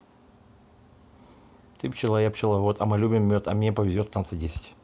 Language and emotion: Russian, neutral